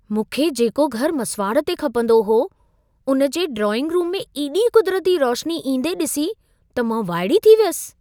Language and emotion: Sindhi, surprised